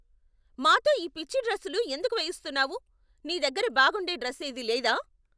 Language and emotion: Telugu, angry